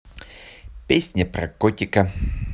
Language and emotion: Russian, positive